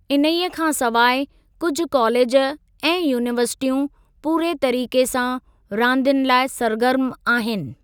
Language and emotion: Sindhi, neutral